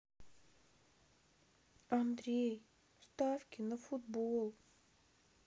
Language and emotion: Russian, sad